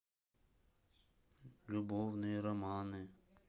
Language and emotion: Russian, sad